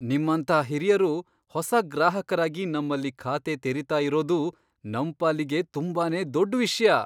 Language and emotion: Kannada, surprised